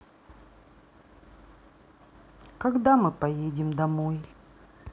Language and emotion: Russian, sad